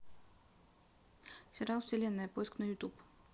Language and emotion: Russian, neutral